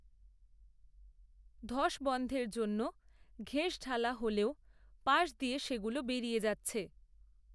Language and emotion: Bengali, neutral